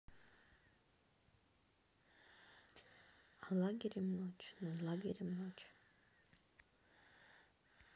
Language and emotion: Russian, neutral